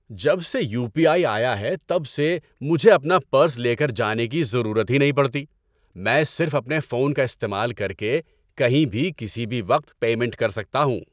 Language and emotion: Urdu, happy